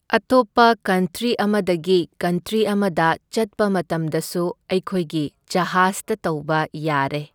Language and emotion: Manipuri, neutral